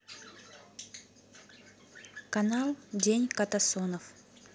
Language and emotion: Russian, neutral